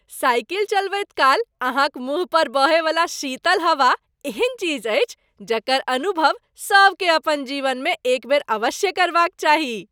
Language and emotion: Maithili, happy